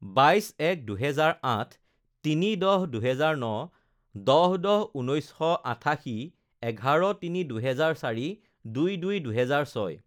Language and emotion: Assamese, neutral